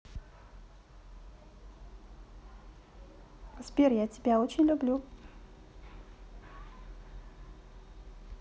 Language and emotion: Russian, positive